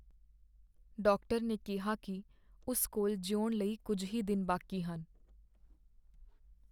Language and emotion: Punjabi, sad